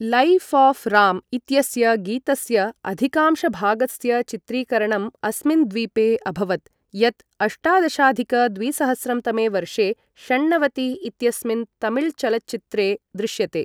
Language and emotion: Sanskrit, neutral